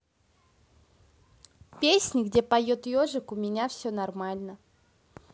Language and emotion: Russian, neutral